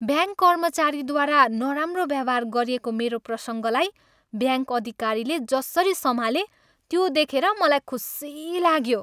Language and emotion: Nepali, happy